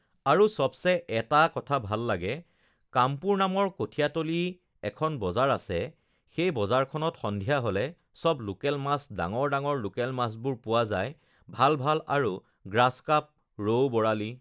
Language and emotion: Assamese, neutral